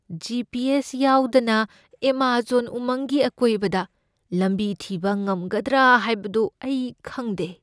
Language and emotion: Manipuri, fearful